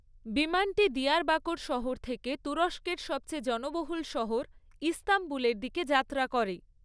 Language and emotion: Bengali, neutral